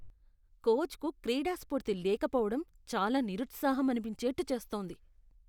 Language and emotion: Telugu, disgusted